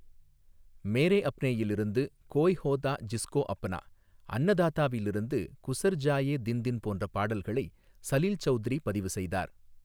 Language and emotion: Tamil, neutral